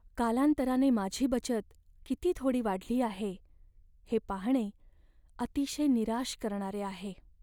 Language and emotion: Marathi, sad